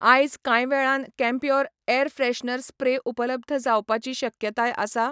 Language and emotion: Goan Konkani, neutral